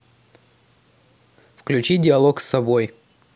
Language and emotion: Russian, neutral